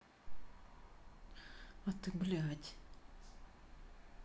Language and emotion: Russian, neutral